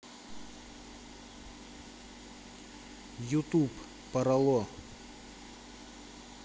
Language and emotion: Russian, neutral